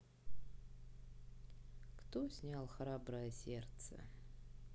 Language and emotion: Russian, sad